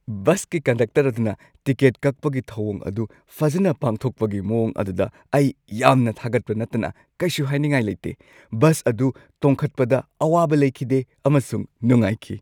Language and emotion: Manipuri, happy